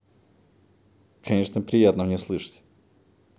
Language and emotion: Russian, neutral